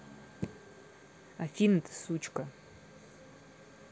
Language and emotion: Russian, neutral